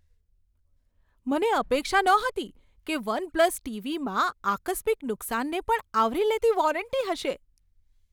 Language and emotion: Gujarati, surprised